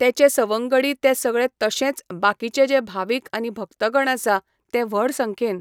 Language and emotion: Goan Konkani, neutral